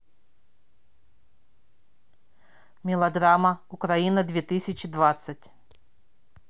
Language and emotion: Russian, neutral